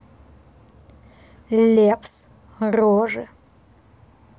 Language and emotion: Russian, neutral